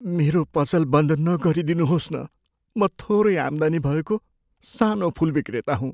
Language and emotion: Nepali, fearful